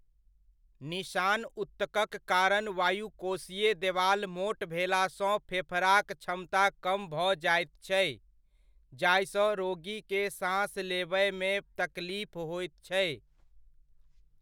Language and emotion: Maithili, neutral